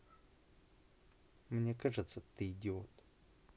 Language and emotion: Russian, neutral